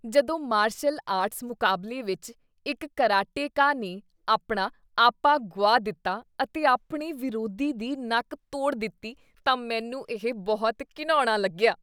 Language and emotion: Punjabi, disgusted